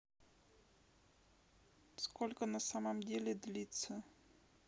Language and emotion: Russian, neutral